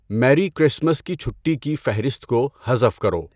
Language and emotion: Urdu, neutral